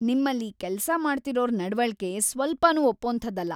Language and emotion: Kannada, angry